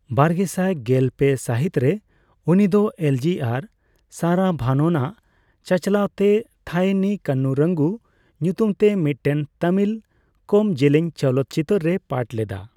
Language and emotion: Santali, neutral